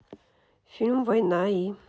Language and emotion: Russian, neutral